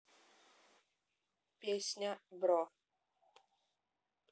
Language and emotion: Russian, neutral